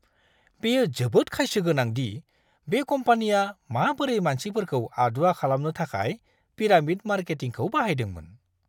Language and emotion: Bodo, disgusted